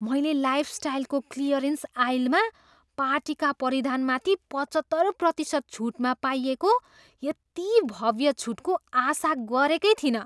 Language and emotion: Nepali, surprised